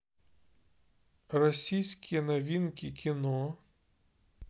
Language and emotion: Russian, neutral